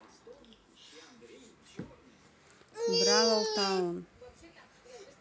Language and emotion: Russian, neutral